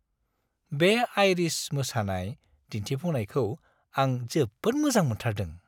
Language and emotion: Bodo, happy